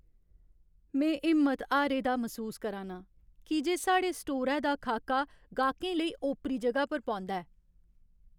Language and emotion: Dogri, sad